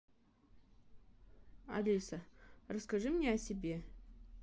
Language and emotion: Russian, neutral